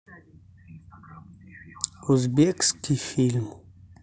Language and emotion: Russian, sad